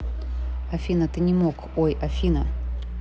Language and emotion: Russian, neutral